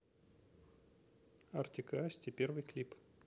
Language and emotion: Russian, neutral